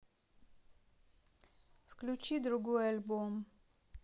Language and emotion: Russian, neutral